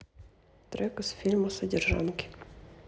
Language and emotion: Russian, sad